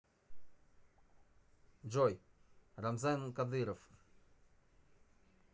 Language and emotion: Russian, neutral